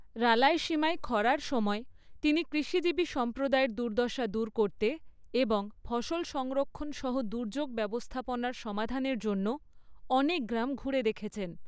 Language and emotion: Bengali, neutral